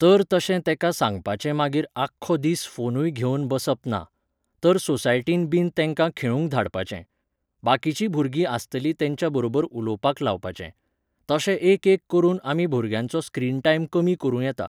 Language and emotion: Goan Konkani, neutral